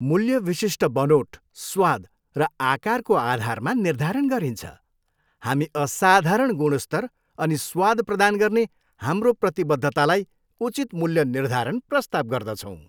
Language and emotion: Nepali, happy